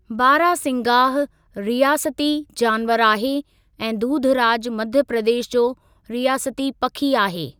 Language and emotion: Sindhi, neutral